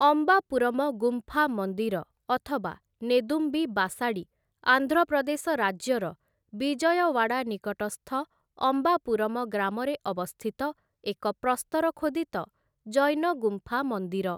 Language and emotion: Odia, neutral